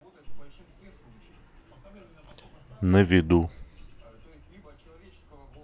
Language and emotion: Russian, neutral